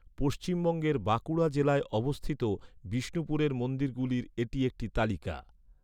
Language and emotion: Bengali, neutral